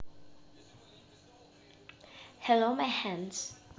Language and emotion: Russian, positive